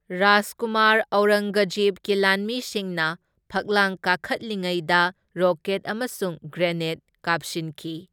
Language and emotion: Manipuri, neutral